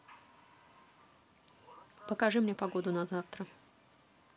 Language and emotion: Russian, neutral